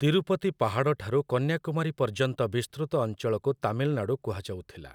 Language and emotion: Odia, neutral